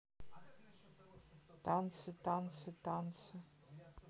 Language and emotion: Russian, neutral